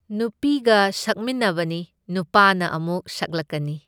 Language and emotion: Manipuri, neutral